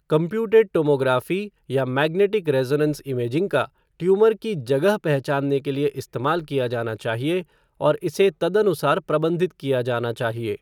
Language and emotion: Hindi, neutral